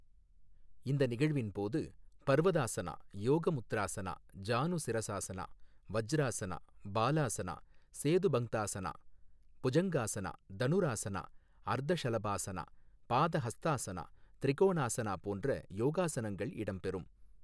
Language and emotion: Tamil, neutral